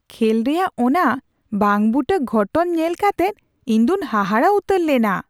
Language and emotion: Santali, surprised